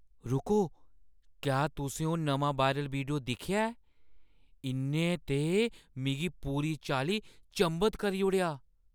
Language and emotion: Dogri, surprised